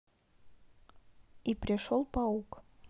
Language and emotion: Russian, neutral